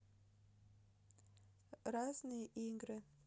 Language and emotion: Russian, neutral